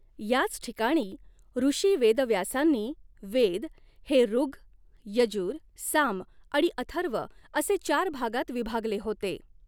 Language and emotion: Marathi, neutral